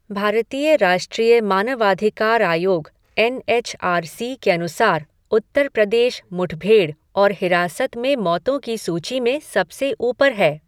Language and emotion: Hindi, neutral